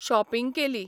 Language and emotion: Goan Konkani, neutral